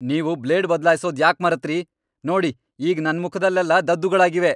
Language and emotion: Kannada, angry